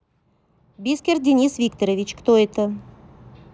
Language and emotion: Russian, neutral